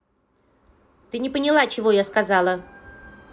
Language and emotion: Russian, angry